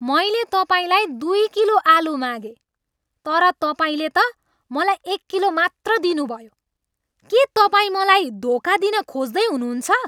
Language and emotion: Nepali, angry